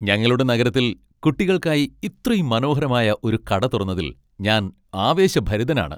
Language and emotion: Malayalam, happy